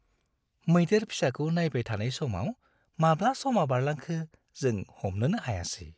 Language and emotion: Bodo, happy